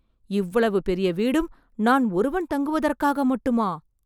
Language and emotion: Tamil, surprised